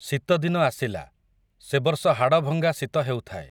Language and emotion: Odia, neutral